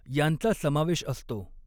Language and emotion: Marathi, neutral